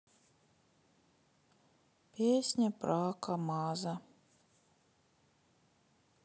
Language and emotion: Russian, sad